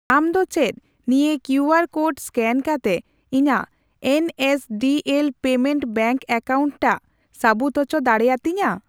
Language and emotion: Santali, neutral